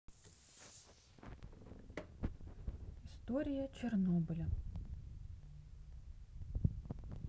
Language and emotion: Russian, neutral